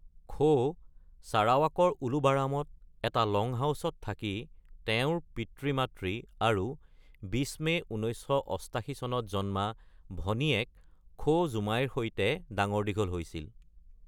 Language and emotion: Assamese, neutral